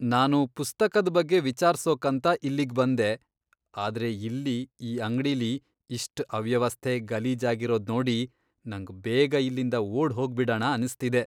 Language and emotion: Kannada, disgusted